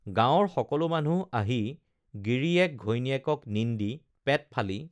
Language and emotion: Assamese, neutral